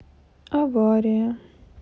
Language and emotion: Russian, sad